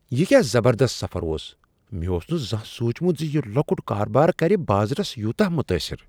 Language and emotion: Kashmiri, surprised